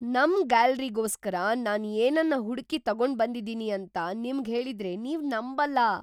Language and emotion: Kannada, surprised